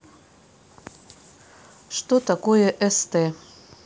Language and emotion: Russian, neutral